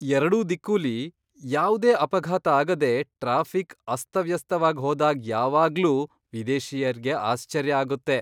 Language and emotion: Kannada, surprised